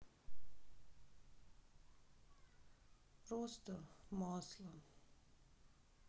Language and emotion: Russian, sad